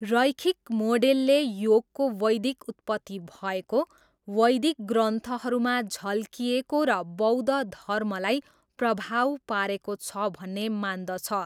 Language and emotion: Nepali, neutral